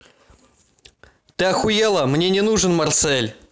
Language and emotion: Russian, angry